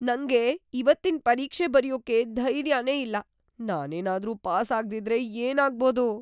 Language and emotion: Kannada, fearful